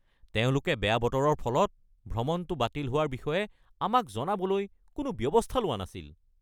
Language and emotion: Assamese, angry